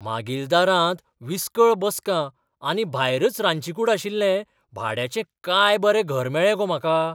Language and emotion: Goan Konkani, surprised